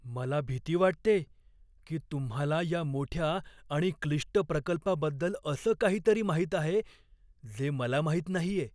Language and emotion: Marathi, fearful